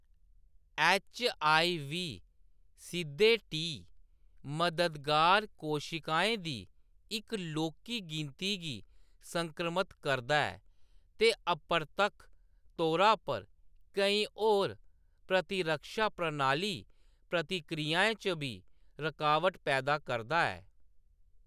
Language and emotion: Dogri, neutral